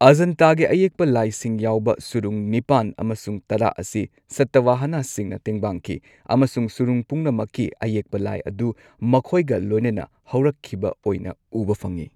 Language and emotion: Manipuri, neutral